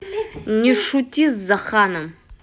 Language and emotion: Russian, angry